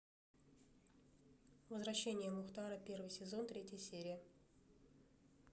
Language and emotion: Russian, neutral